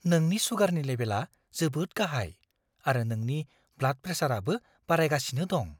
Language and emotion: Bodo, fearful